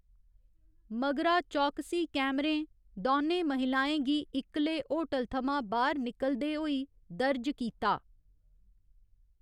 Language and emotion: Dogri, neutral